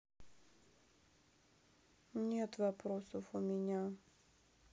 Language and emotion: Russian, sad